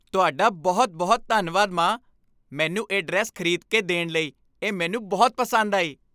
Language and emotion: Punjabi, happy